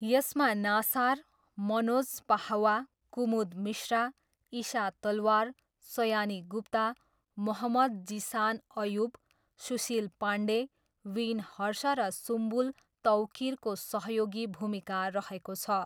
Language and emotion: Nepali, neutral